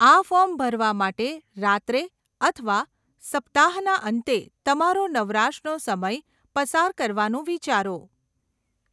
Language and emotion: Gujarati, neutral